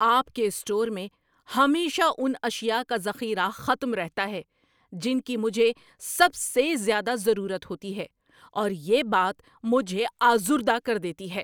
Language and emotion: Urdu, angry